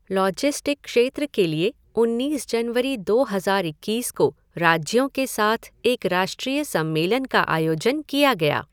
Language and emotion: Hindi, neutral